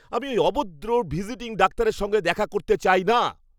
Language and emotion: Bengali, angry